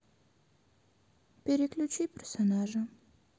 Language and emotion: Russian, sad